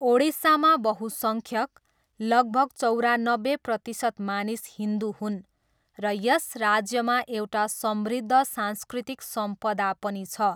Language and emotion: Nepali, neutral